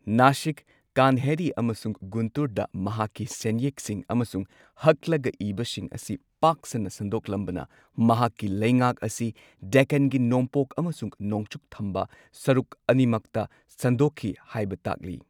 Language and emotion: Manipuri, neutral